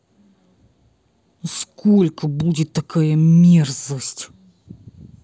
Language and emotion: Russian, angry